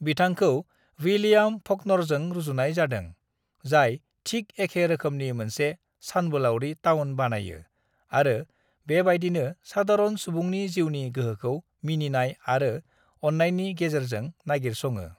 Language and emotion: Bodo, neutral